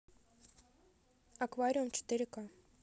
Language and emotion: Russian, neutral